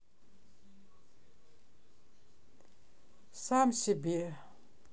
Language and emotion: Russian, sad